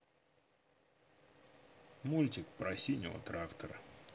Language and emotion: Russian, neutral